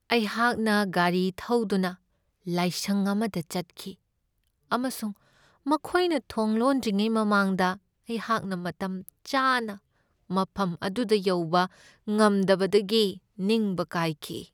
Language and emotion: Manipuri, sad